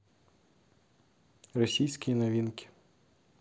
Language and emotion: Russian, neutral